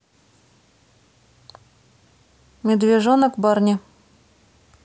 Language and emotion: Russian, neutral